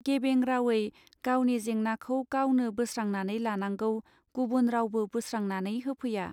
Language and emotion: Bodo, neutral